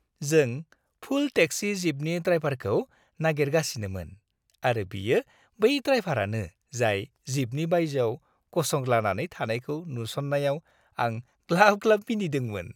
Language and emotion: Bodo, happy